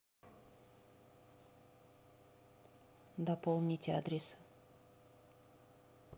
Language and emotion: Russian, neutral